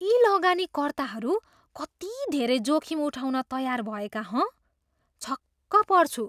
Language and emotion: Nepali, surprised